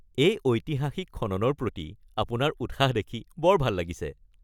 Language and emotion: Assamese, happy